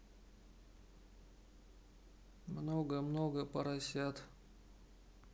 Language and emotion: Russian, neutral